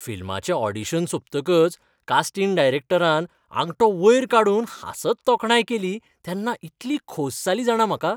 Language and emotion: Goan Konkani, happy